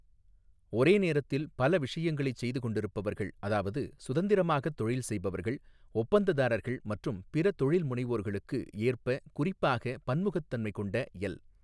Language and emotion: Tamil, neutral